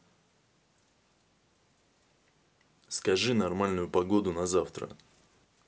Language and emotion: Russian, neutral